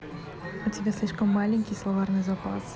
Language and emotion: Russian, neutral